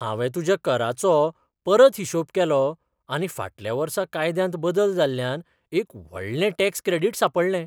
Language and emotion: Goan Konkani, surprised